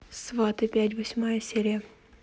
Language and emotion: Russian, neutral